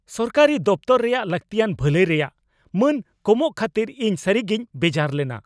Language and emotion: Santali, angry